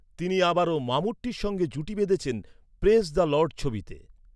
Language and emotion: Bengali, neutral